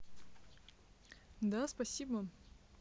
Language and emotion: Russian, positive